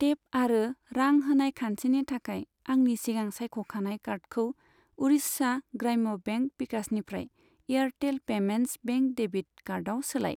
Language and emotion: Bodo, neutral